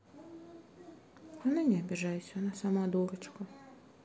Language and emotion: Russian, sad